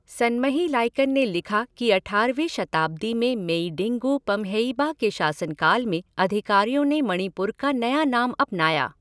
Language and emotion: Hindi, neutral